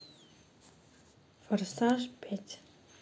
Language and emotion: Russian, neutral